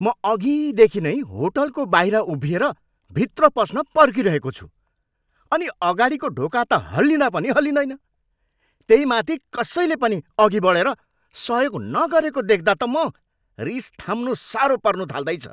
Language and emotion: Nepali, angry